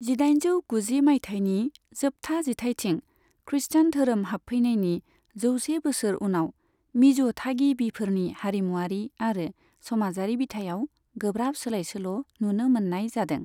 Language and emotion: Bodo, neutral